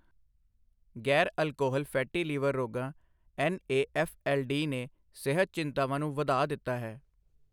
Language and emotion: Punjabi, neutral